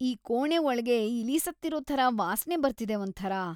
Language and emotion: Kannada, disgusted